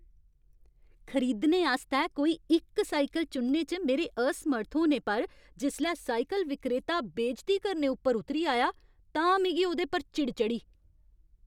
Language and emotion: Dogri, angry